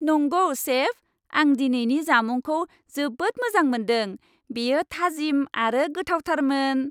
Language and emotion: Bodo, happy